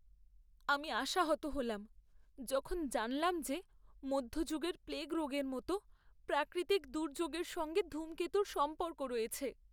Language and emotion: Bengali, sad